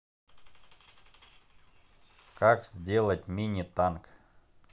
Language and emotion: Russian, neutral